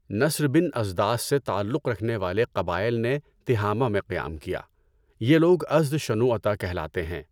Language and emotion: Urdu, neutral